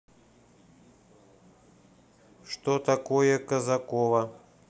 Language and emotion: Russian, neutral